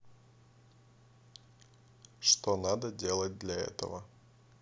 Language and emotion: Russian, neutral